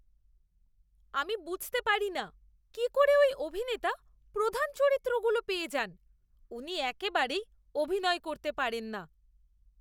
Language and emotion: Bengali, disgusted